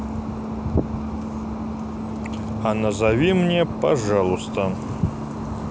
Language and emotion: Russian, neutral